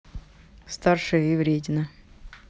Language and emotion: Russian, neutral